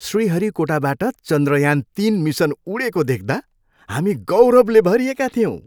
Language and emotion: Nepali, happy